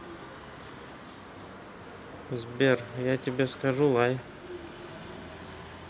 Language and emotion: Russian, neutral